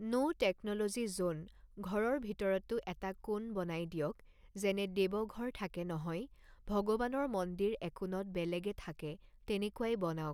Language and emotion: Assamese, neutral